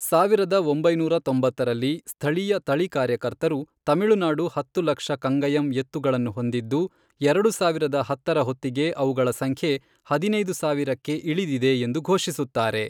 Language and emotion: Kannada, neutral